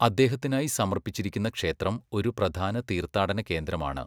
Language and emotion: Malayalam, neutral